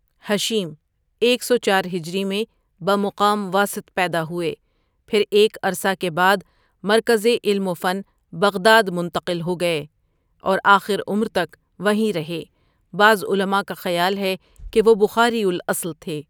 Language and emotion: Urdu, neutral